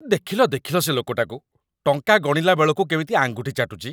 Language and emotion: Odia, disgusted